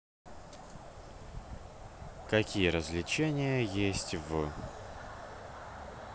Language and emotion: Russian, neutral